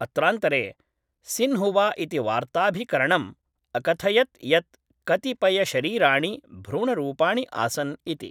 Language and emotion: Sanskrit, neutral